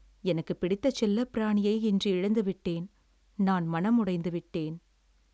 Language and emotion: Tamil, sad